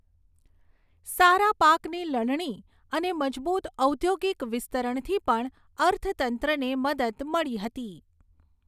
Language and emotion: Gujarati, neutral